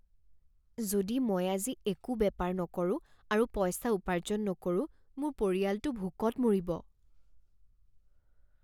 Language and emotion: Assamese, fearful